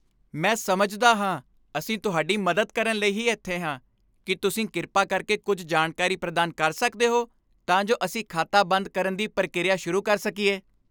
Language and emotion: Punjabi, happy